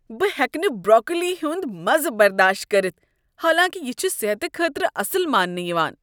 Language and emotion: Kashmiri, disgusted